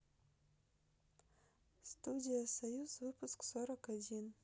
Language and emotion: Russian, neutral